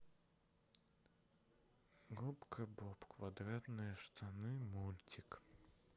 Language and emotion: Russian, sad